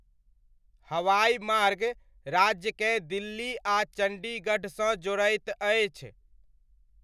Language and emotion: Maithili, neutral